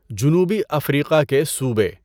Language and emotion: Urdu, neutral